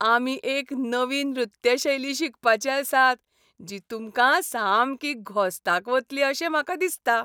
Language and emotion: Goan Konkani, happy